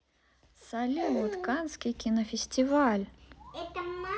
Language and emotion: Russian, positive